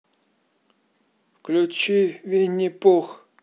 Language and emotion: Russian, neutral